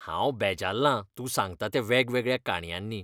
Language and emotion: Goan Konkani, disgusted